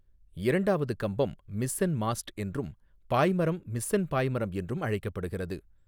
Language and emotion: Tamil, neutral